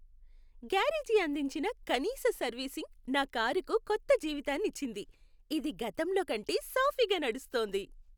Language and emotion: Telugu, happy